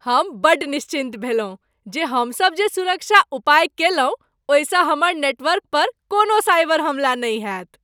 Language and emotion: Maithili, happy